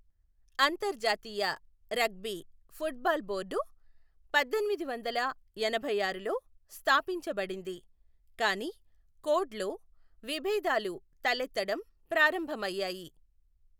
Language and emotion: Telugu, neutral